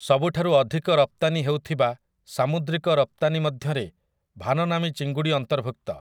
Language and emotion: Odia, neutral